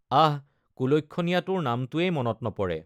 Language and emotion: Assamese, neutral